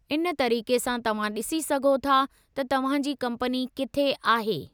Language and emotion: Sindhi, neutral